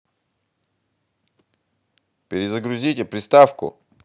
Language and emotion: Russian, angry